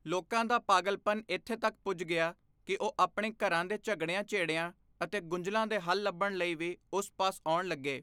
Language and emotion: Punjabi, neutral